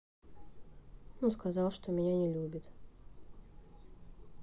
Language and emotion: Russian, sad